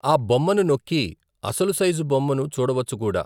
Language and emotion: Telugu, neutral